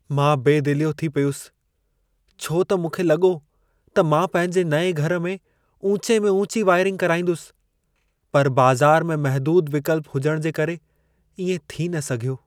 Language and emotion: Sindhi, sad